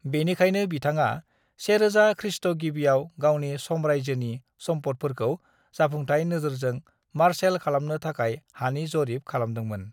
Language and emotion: Bodo, neutral